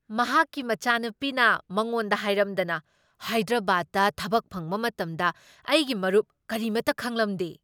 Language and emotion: Manipuri, surprised